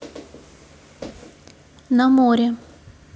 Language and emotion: Russian, neutral